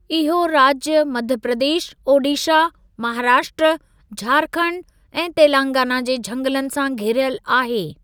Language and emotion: Sindhi, neutral